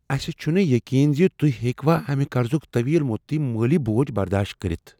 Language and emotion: Kashmiri, fearful